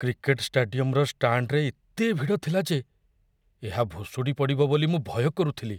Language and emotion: Odia, fearful